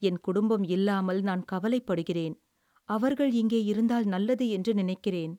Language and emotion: Tamil, sad